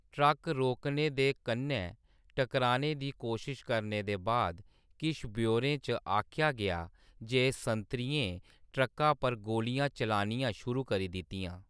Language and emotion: Dogri, neutral